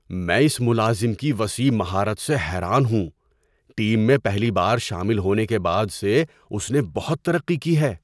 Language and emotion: Urdu, surprised